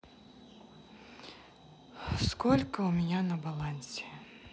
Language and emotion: Russian, sad